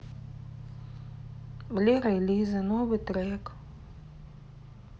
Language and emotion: Russian, neutral